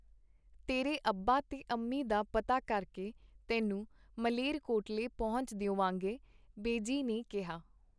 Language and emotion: Punjabi, neutral